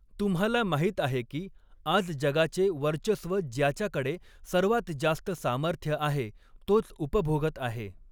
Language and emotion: Marathi, neutral